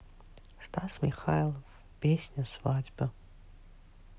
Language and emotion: Russian, sad